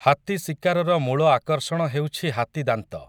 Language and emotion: Odia, neutral